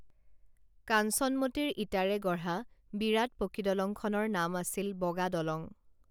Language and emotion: Assamese, neutral